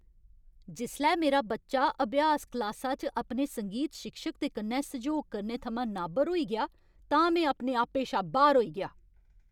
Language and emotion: Dogri, angry